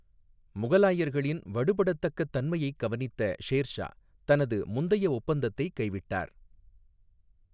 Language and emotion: Tamil, neutral